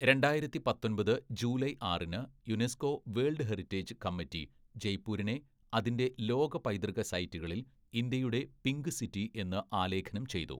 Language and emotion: Malayalam, neutral